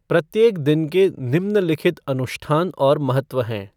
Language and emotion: Hindi, neutral